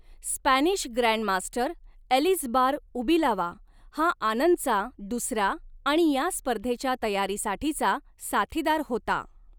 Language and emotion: Marathi, neutral